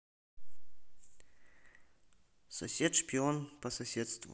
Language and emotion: Russian, neutral